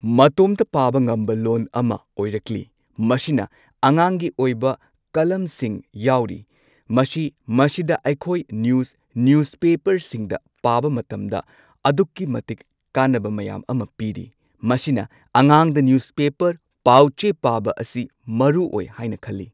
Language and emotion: Manipuri, neutral